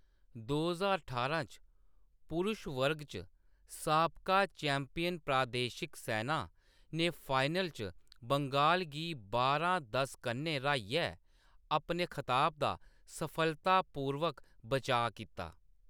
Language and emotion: Dogri, neutral